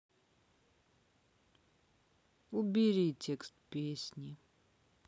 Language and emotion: Russian, neutral